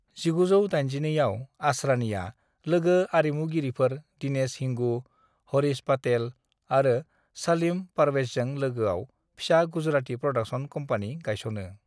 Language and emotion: Bodo, neutral